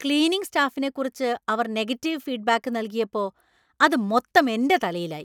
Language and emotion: Malayalam, angry